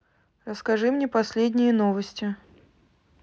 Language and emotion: Russian, neutral